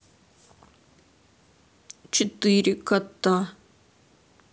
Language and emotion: Russian, sad